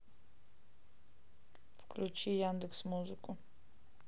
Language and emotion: Russian, neutral